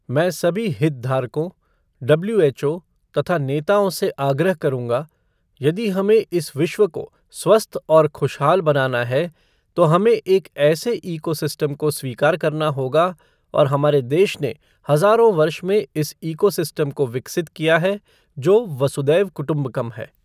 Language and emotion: Hindi, neutral